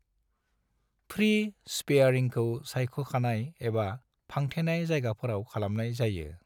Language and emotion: Bodo, neutral